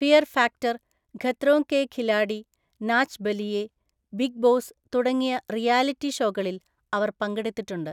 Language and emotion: Malayalam, neutral